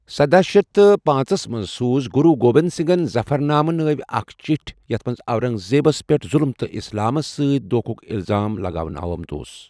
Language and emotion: Kashmiri, neutral